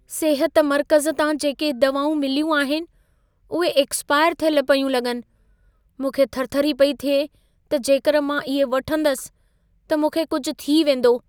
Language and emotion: Sindhi, fearful